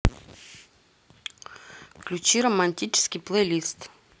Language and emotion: Russian, neutral